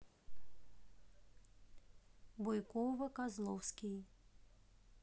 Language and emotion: Russian, neutral